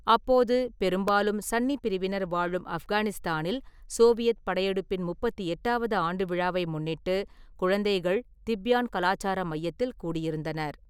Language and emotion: Tamil, neutral